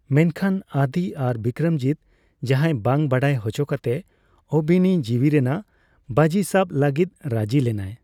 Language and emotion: Santali, neutral